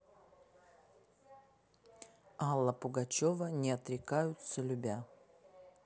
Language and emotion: Russian, neutral